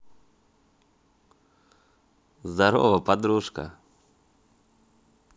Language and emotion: Russian, positive